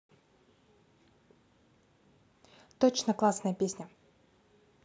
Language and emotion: Russian, positive